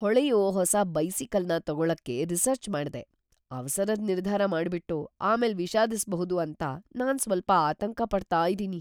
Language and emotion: Kannada, fearful